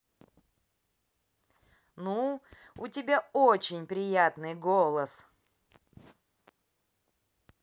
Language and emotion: Russian, positive